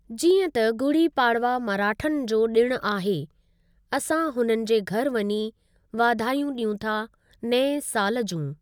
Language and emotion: Sindhi, neutral